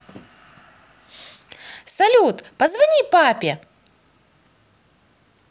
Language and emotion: Russian, positive